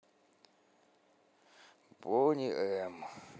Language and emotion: Russian, sad